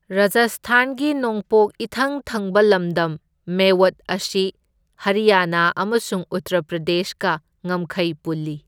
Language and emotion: Manipuri, neutral